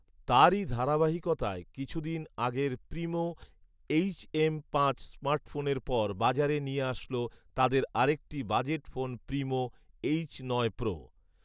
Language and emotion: Bengali, neutral